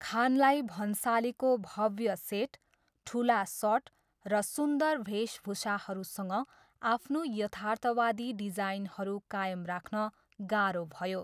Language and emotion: Nepali, neutral